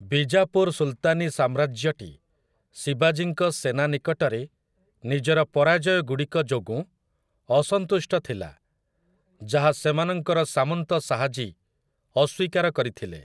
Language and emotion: Odia, neutral